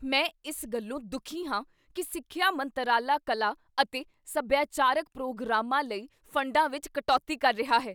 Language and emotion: Punjabi, angry